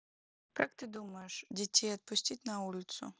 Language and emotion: Russian, neutral